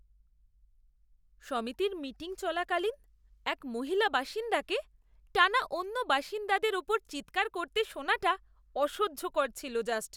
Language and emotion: Bengali, disgusted